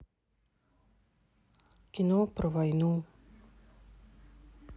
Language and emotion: Russian, neutral